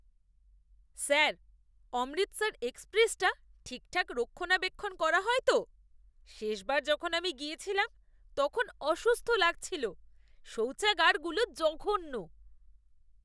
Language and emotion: Bengali, disgusted